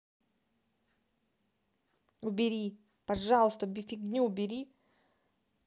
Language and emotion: Russian, angry